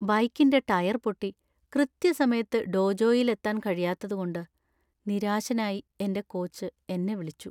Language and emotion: Malayalam, sad